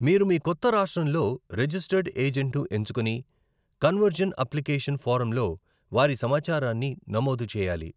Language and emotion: Telugu, neutral